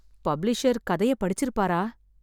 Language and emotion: Tamil, sad